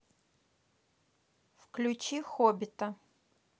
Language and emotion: Russian, neutral